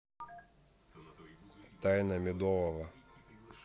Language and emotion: Russian, neutral